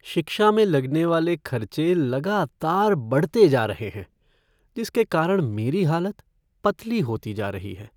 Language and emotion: Hindi, sad